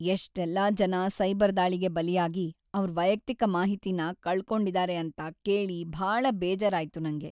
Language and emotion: Kannada, sad